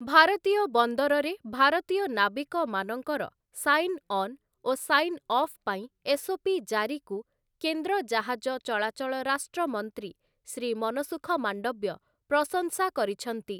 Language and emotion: Odia, neutral